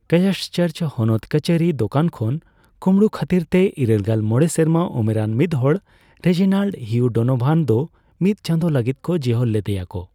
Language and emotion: Santali, neutral